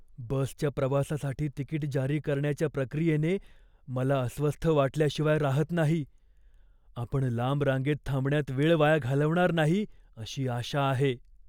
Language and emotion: Marathi, fearful